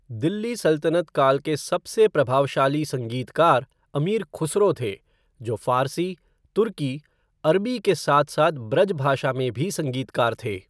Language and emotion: Hindi, neutral